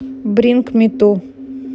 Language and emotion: Russian, neutral